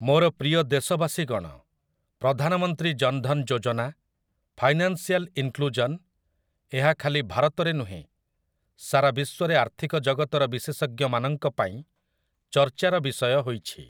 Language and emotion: Odia, neutral